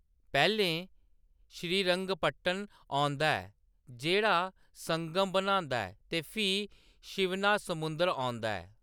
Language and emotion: Dogri, neutral